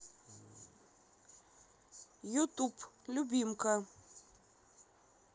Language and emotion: Russian, neutral